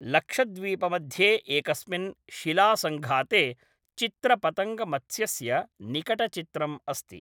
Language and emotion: Sanskrit, neutral